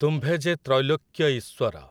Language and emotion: Odia, neutral